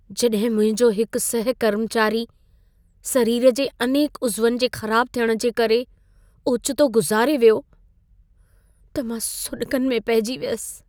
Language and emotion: Sindhi, sad